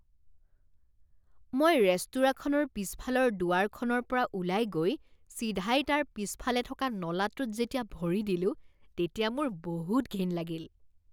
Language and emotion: Assamese, disgusted